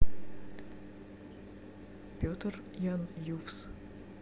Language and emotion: Russian, neutral